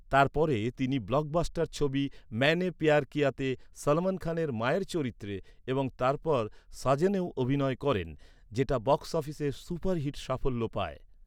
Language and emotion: Bengali, neutral